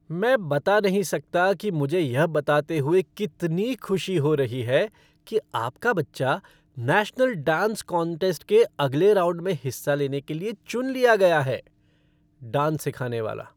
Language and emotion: Hindi, happy